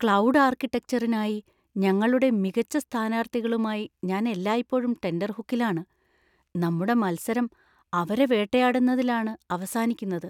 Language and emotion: Malayalam, fearful